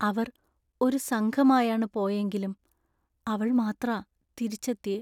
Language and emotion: Malayalam, sad